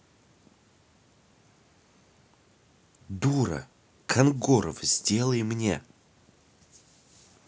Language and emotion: Russian, angry